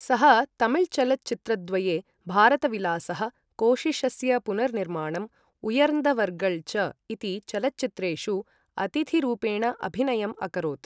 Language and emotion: Sanskrit, neutral